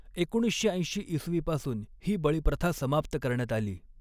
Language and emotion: Marathi, neutral